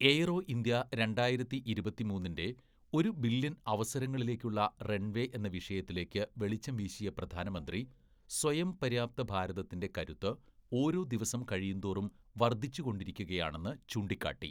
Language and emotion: Malayalam, neutral